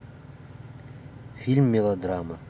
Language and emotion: Russian, neutral